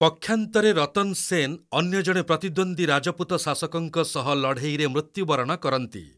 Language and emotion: Odia, neutral